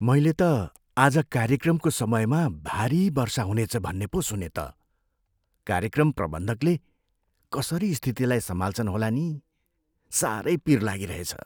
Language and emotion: Nepali, fearful